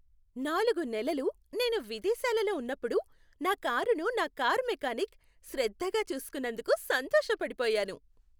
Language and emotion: Telugu, happy